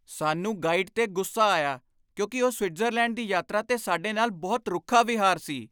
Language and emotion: Punjabi, angry